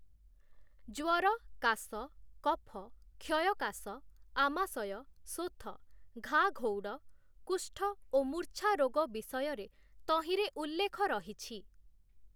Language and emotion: Odia, neutral